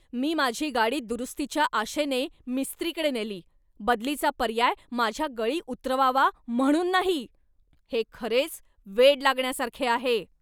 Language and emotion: Marathi, angry